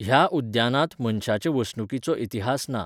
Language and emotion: Goan Konkani, neutral